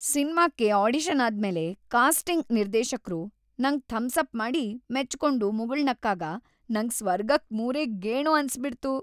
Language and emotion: Kannada, happy